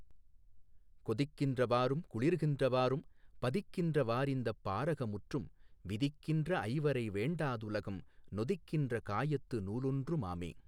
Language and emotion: Tamil, neutral